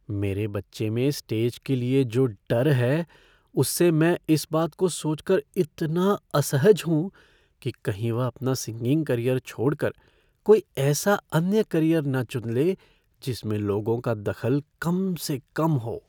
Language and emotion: Hindi, fearful